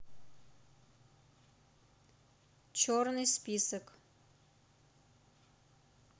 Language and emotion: Russian, neutral